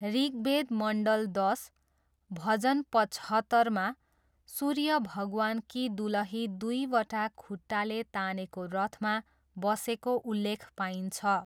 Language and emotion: Nepali, neutral